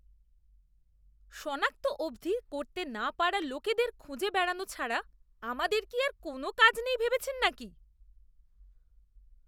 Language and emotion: Bengali, disgusted